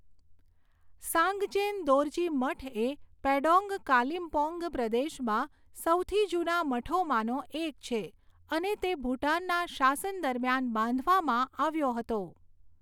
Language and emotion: Gujarati, neutral